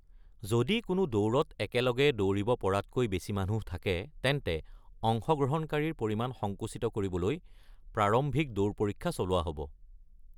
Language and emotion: Assamese, neutral